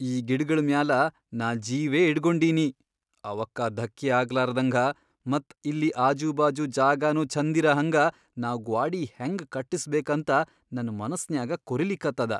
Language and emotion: Kannada, fearful